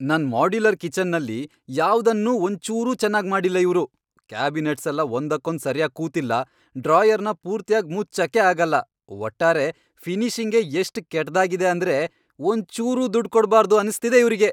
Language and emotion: Kannada, angry